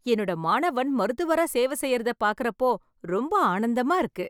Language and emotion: Tamil, happy